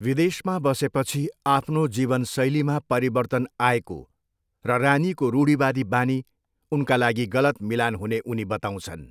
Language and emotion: Nepali, neutral